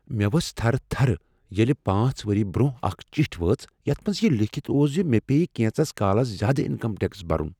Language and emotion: Kashmiri, fearful